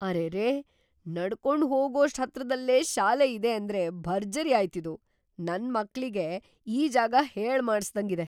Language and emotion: Kannada, surprised